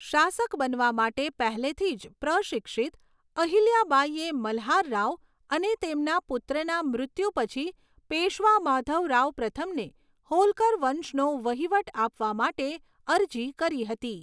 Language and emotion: Gujarati, neutral